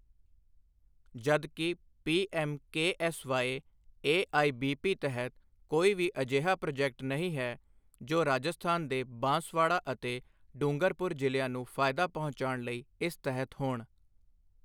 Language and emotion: Punjabi, neutral